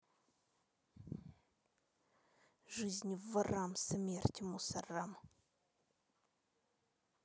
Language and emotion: Russian, angry